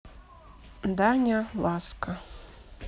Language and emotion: Russian, neutral